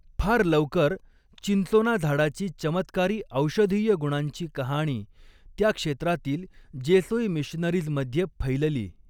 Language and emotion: Marathi, neutral